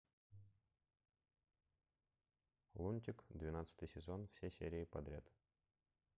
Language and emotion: Russian, neutral